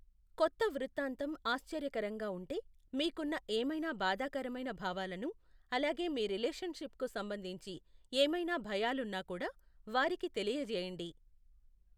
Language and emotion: Telugu, neutral